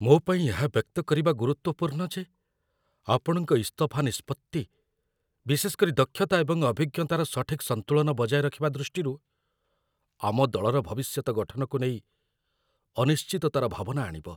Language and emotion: Odia, fearful